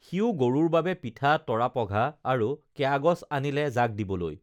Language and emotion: Assamese, neutral